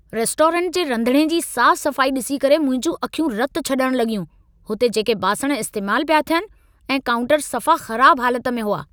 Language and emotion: Sindhi, angry